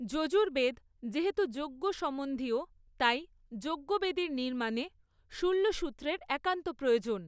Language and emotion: Bengali, neutral